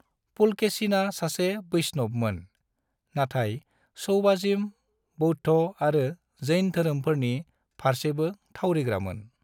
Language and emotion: Bodo, neutral